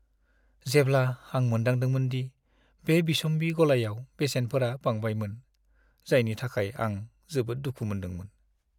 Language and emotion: Bodo, sad